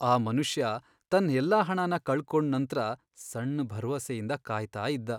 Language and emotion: Kannada, sad